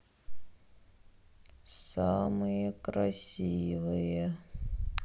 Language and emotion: Russian, sad